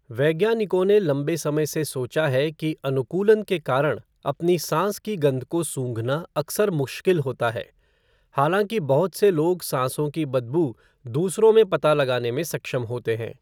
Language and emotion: Hindi, neutral